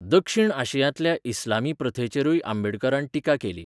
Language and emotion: Goan Konkani, neutral